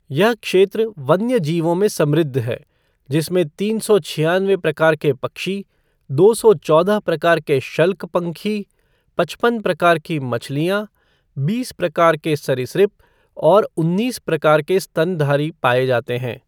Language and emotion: Hindi, neutral